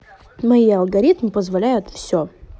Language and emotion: Russian, neutral